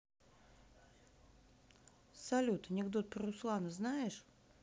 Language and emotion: Russian, neutral